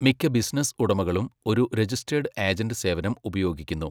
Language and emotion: Malayalam, neutral